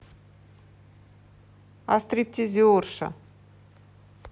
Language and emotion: Russian, neutral